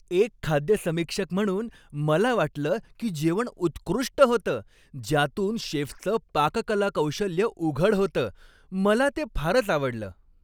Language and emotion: Marathi, happy